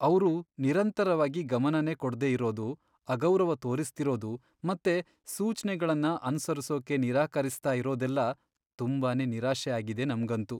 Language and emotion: Kannada, sad